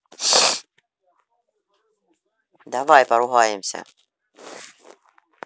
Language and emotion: Russian, neutral